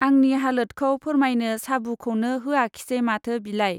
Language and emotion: Bodo, neutral